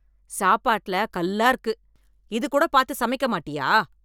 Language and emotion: Tamil, angry